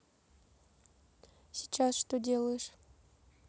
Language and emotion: Russian, neutral